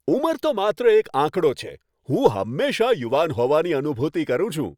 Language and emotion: Gujarati, happy